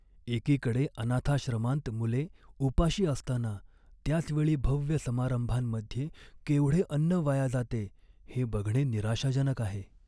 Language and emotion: Marathi, sad